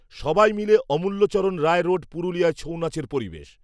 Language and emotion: Bengali, neutral